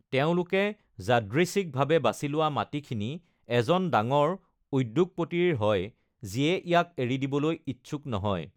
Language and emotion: Assamese, neutral